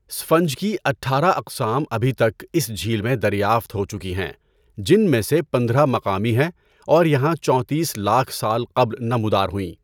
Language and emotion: Urdu, neutral